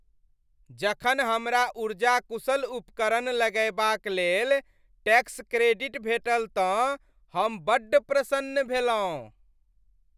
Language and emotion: Maithili, happy